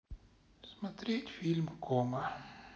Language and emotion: Russian, sad